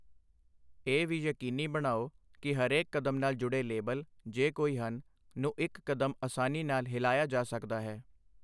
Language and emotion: Punjabi, neutral